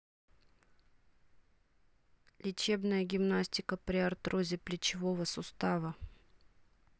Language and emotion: Russian, neutral